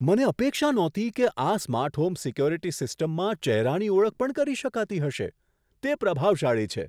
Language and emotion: Gujarati, surprised